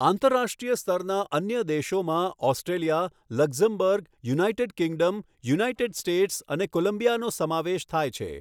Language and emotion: Gujarati, neutral